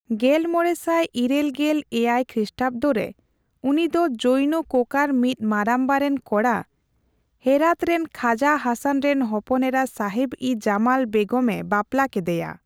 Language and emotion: Santali, neutral